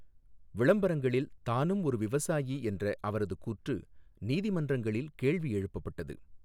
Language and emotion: Tamil, neutral